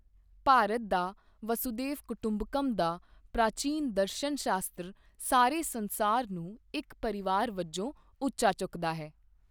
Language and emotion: Punjabi, neutral